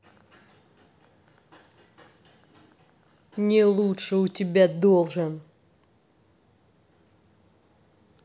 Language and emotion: Russian, angry